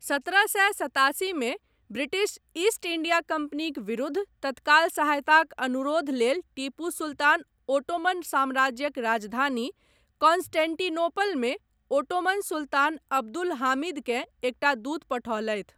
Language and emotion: Maithili, neutral